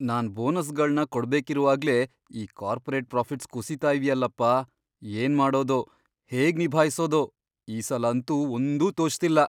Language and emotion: Kannada, fearful